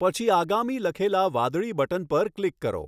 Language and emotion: Gujarati, neutral